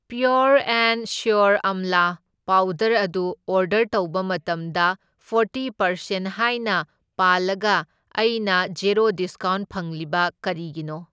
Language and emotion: Manipuri, neutral